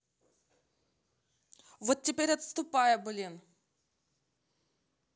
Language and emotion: Russian, angry